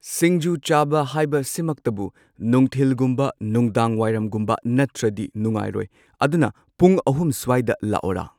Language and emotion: Manipuri, neutral